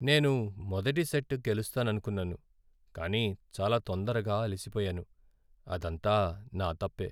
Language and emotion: Telugu, sad